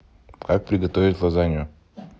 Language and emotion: Russian, neutral